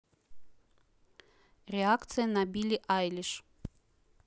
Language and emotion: Russian, neutral